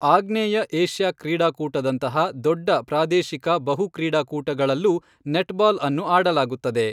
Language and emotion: Kannada, neutral